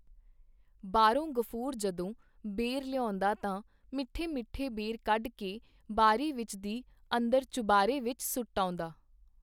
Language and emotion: Punjabi, neutral